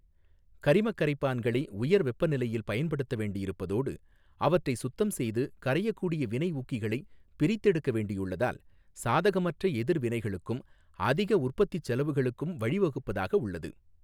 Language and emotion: Tamil, neutral